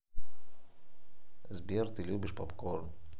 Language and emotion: Russian, neutral